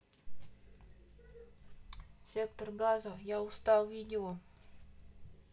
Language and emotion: Russian, neutral